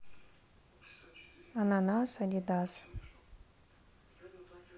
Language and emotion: Russian, neutral